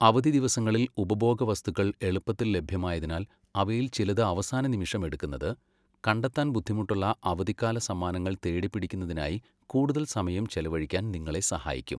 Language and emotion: Malayalam, neutral